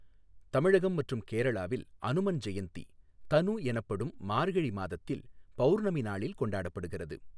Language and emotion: Tamil, neutral